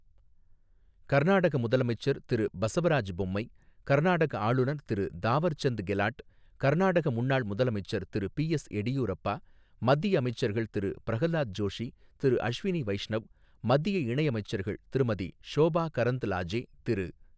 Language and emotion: Tamil, neutral